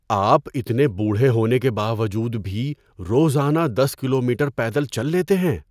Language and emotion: Urdu, surprised